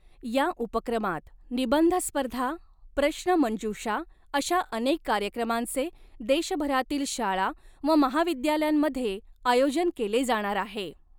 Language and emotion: Marathi, neutral